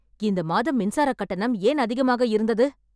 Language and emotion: Tamil, angry